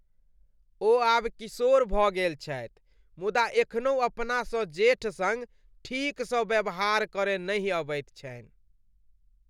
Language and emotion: Maithili, disgusted